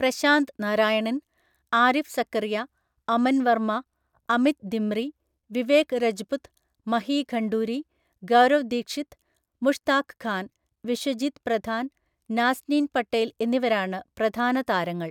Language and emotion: Malayalam, neutral